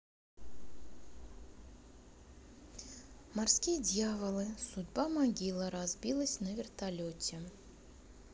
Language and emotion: Russian, neutral